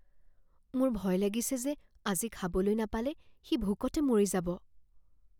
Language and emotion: Assamese, fearful